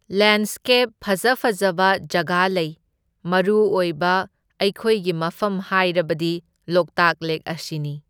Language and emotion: Manipuri, neutral